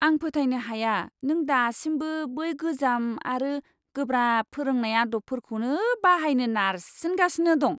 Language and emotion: Bodo, disgusted